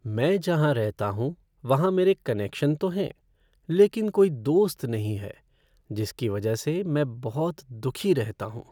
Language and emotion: Hindi, sad